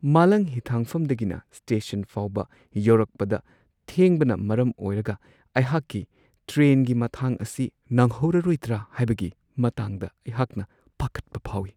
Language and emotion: Manipuri, fearful